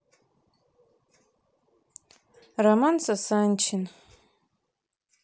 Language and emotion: Russian, neutral